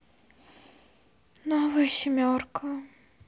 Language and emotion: Russian, sad